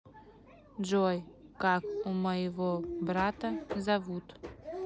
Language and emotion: Russian, neutral